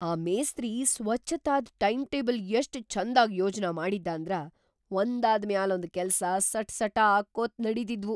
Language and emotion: Kannada, surprised